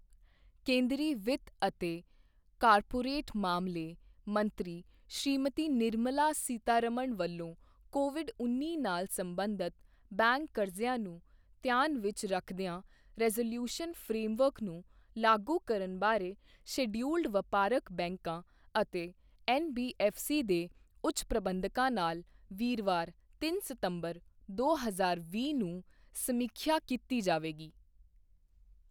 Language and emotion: Punjabi, neutral